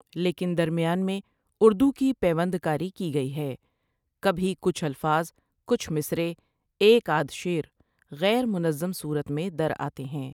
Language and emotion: Urdu, neutral